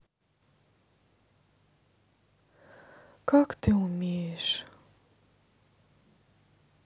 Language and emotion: Russian, sad